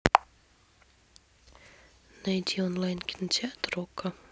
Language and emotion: Russian, neutral